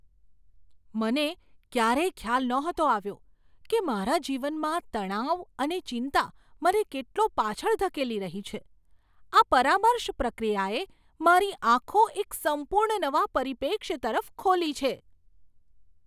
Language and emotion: Gujarati, surprised